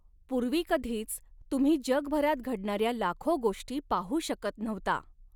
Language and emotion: Marathi, neutral